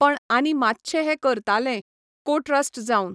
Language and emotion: Goan Konkani, neutral